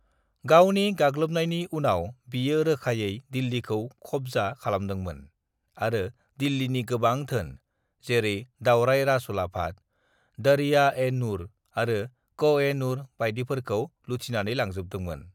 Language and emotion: Bodo, neutral